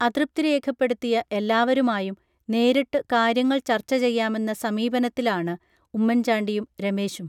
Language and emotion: Malayalam, neutral